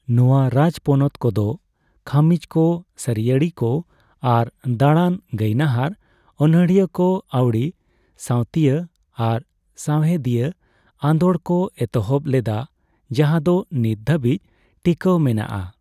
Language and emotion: Santali, neutral